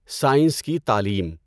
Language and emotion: Urdu, neutral